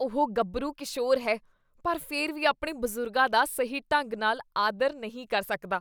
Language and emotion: Punjabi, disgusted